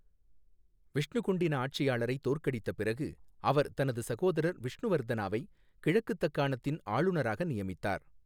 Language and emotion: Tamil, neutral